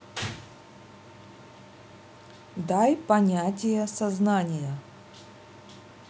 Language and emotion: Russian, neutral